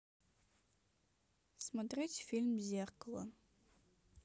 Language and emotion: Russian, neutral